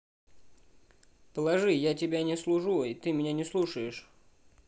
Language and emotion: Russian, neutral